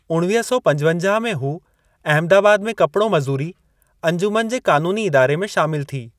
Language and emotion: Sindhi, neutral